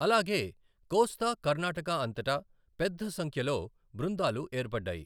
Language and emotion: Telugu, neutral